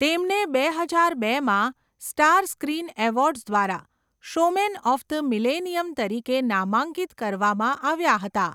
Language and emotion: Gujarati, neutral